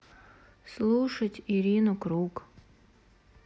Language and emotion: Russian, sad